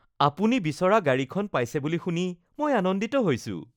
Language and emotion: Assamese, happy